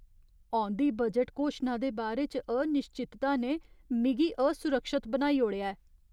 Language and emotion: Dogri, fearful